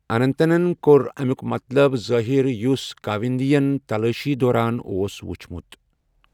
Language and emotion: Kashmiri, neutral